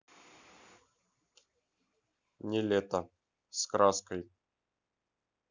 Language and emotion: Russian, neutral